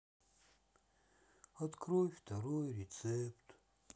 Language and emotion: Russian, sad